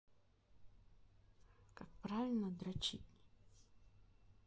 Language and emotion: Russian, neutral